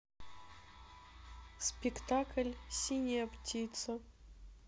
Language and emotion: Russian, sad